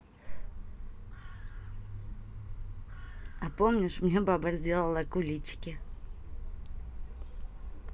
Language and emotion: Russian, positive